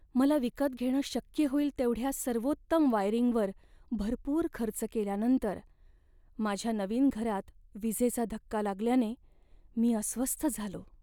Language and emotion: Marathi, sad